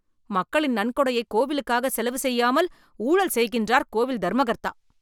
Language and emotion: Tamil, angry